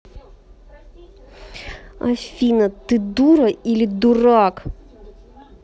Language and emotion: Russian, angry